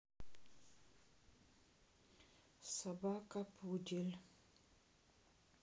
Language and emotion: Russian, sad